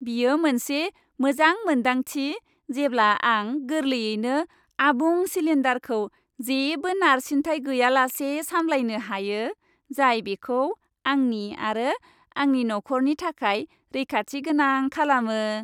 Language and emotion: Bodo, happy